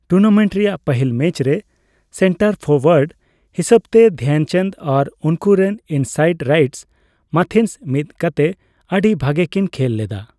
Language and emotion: Santali, neutral